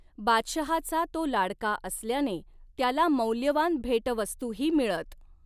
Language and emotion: Marathi, neutral